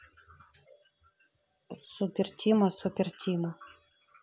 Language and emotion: Russian, neutral